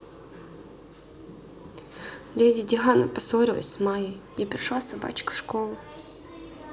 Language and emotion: Russian, sad